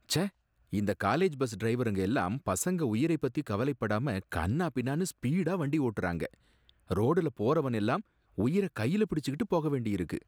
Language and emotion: Tamil, disgusted